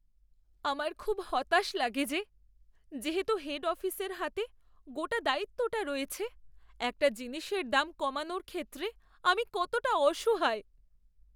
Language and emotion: Bengali, sad